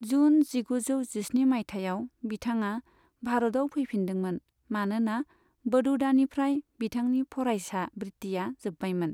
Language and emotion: Bodo, neutral